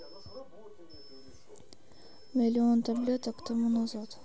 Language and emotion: Russian, neutral